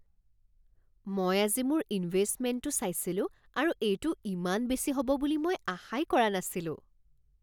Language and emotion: Assamese, surprised